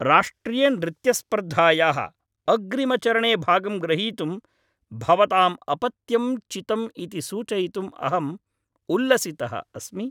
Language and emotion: Sanskrit, happy